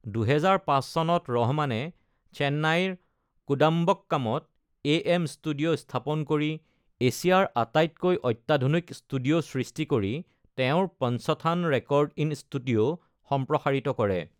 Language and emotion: Assamese, neutral